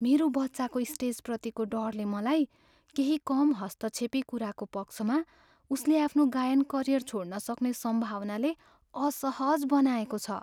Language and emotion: Nepali, fearful